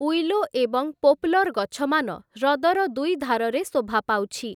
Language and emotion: Odia, neutral